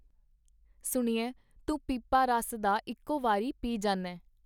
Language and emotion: Punjabi, neutral